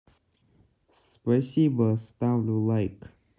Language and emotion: Russian, neutral